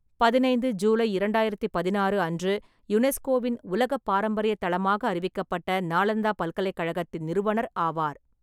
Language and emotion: Tamil, neutral